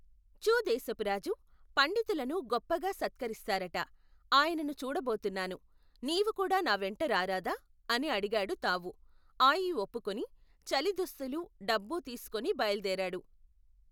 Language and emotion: Telugu, neutral